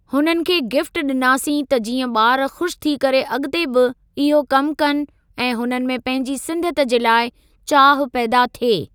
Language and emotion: Sindhi, neutral